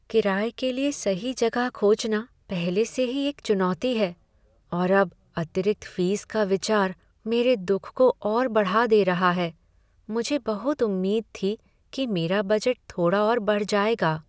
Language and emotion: Hindi, sad